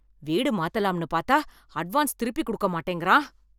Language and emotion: Tamil, angry